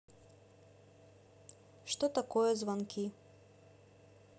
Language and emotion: Russian, neutral